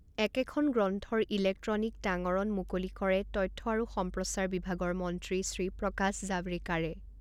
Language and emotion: Assamese, neutral